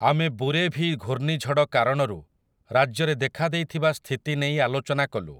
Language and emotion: Odia, neutral